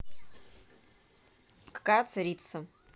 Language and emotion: Russian, neutral